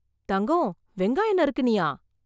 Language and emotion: Tamil, surprised